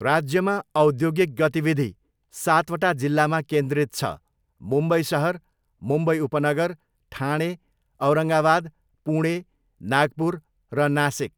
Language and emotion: Nepali, neutral